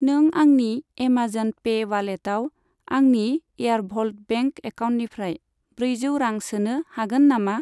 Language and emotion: Bodo, neutral